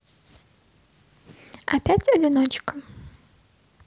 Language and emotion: Russian, neutral